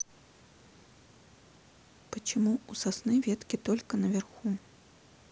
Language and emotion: Russian, neutral